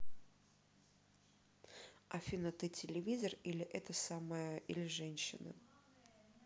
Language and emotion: Russian, neutral